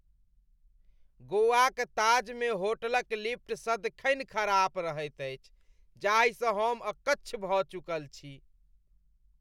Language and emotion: Maithili, disgusted